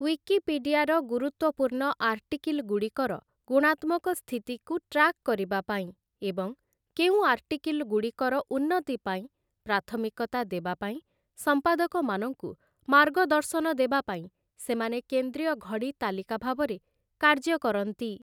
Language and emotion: Odia, neutral